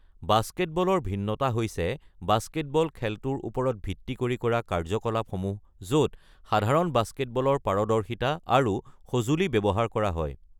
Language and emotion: Assamese, neutral